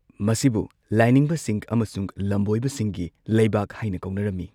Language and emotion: Manipuri, neutral